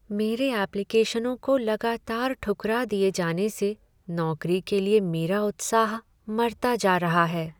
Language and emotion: Hindi, sad